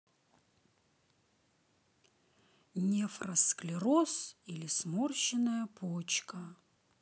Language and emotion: Russian, neutral